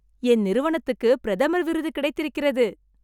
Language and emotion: Tamil, happy